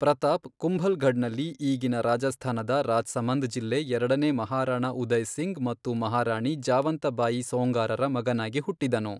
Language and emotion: Kannada, neutral